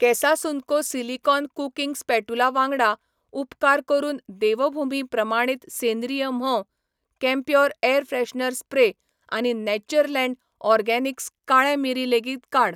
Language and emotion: Goan Konkani, neutral